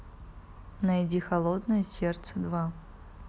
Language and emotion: Russian, neutral